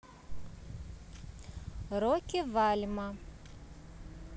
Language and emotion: Russian, neutral